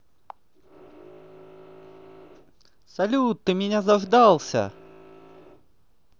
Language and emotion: Russian, positive